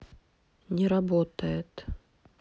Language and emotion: Russian, neutral